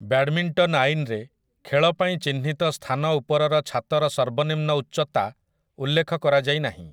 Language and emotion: Odia, neutral